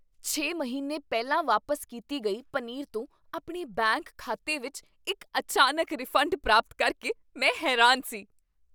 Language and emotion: Punjabi, surprised